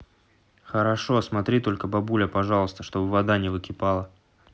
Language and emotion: Russian, neutral